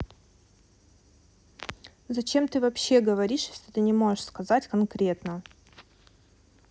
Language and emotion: Russian, angry